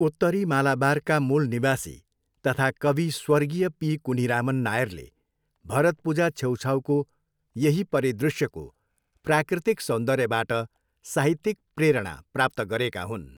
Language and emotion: Nepali, neutral